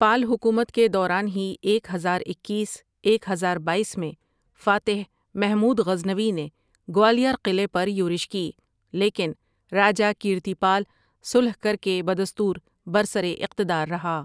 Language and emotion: Urdu, neutral